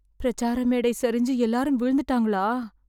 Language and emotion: Tamil, fearful